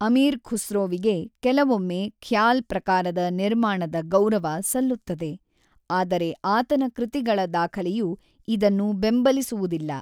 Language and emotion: Kannada, neutral